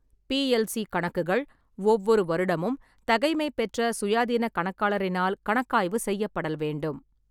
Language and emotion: Tamil, neutral